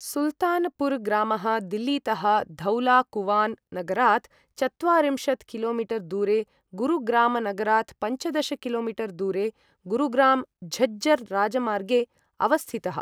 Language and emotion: Sanskrit, neutral